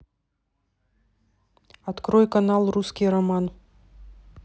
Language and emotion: Russian, neutral